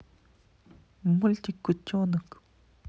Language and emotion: Russian, neutral